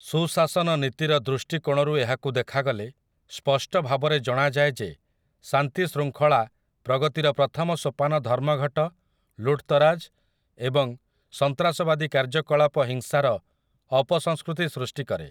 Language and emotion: Odia, neutral